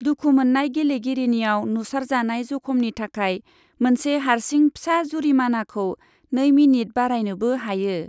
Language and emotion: Bodo, neutral